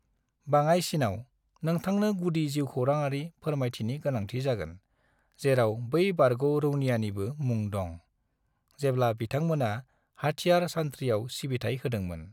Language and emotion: Bodo, neutral